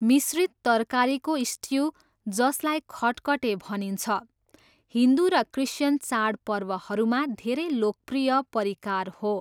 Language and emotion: Nepali, neutral